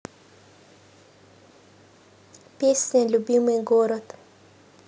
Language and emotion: Russian, neutral